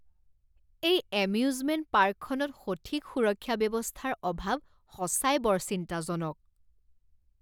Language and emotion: Assamese, disgusted